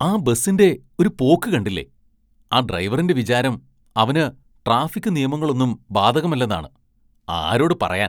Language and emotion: Malayalam, disgusted